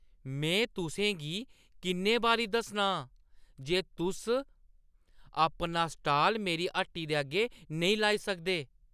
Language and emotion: Dogri, angry